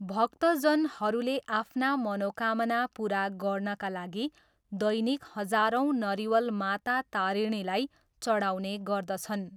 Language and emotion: Nepali, neutral